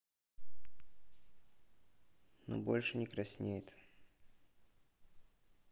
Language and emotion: Russian, neutral